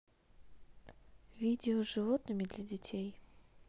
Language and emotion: Russian, neutral